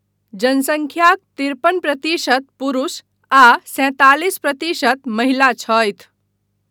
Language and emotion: Maithili, neutral